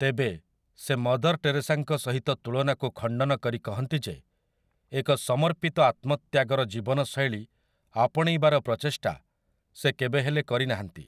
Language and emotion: Odia, neutral